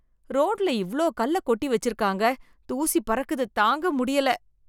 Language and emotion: Tamil, disgusted